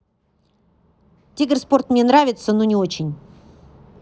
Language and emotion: Russian, neutral